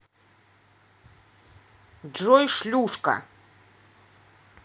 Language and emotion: Russian, angry